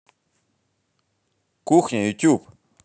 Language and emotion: Russian, positive